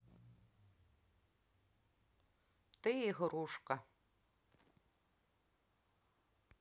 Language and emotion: Russian, neutral